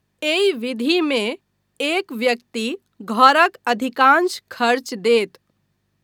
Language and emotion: Maithili, neutral